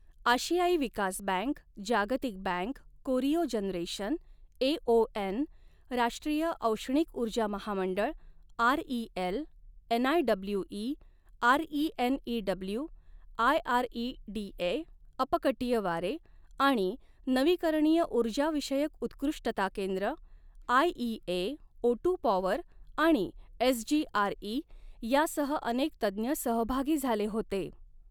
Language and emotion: Marathi, neutral